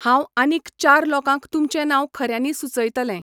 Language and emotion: Goan Konkani, neutral